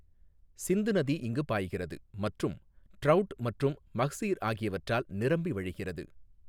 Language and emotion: Tamil, neutral